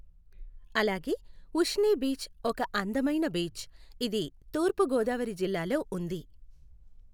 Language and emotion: Telugu, neutral